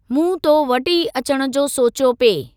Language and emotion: Sindhi, neutral